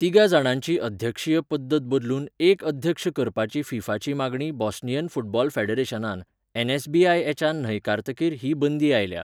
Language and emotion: Goan Konkani, neutral